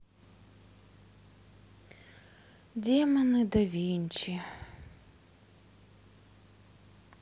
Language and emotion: Russian, sad